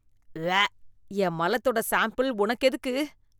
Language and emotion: Tamil, disgusted